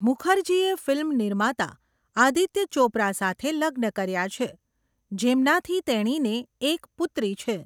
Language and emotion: Gujarati, neutral